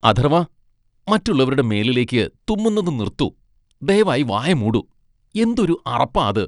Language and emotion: Malayalam, disgusted